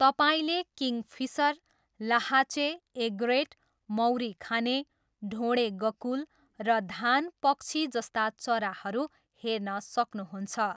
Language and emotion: Nepali, neutral